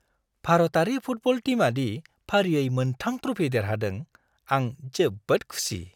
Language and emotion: Bodo, happy